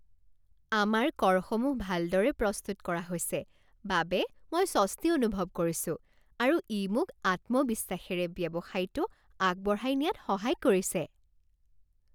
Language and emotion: Assamese, happy